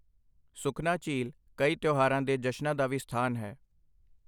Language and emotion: Punjabi, neutral